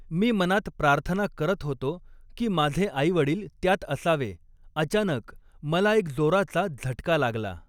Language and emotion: Marathi, neutral